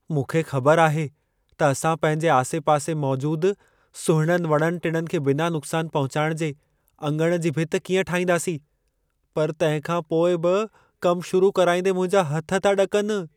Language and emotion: Sindhi, fearful